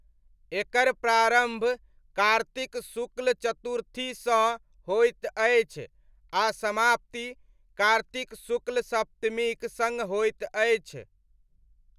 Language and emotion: Maithili, neutral